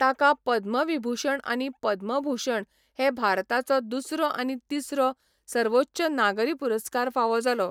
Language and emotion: Goan Konkani, neutral